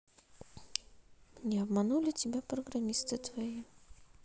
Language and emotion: Russian, neutral